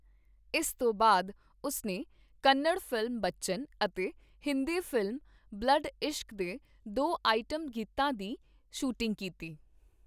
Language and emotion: Punjabi, neutral